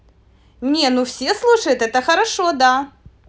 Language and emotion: Russian, positive